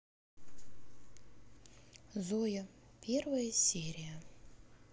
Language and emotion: Russian, neutral